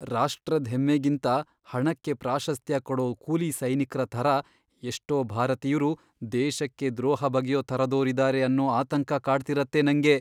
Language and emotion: Kannada, fearful